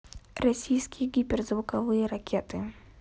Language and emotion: Russian, neutral